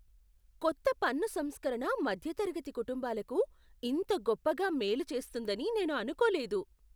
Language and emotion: Telugu, surprised